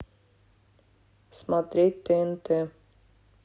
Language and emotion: Russian, neutral